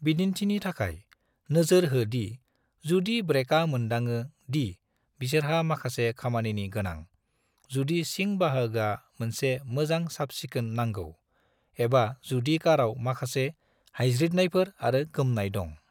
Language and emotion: Bodo, neutral